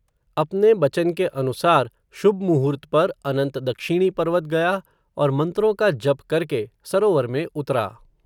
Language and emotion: Hindi, neutral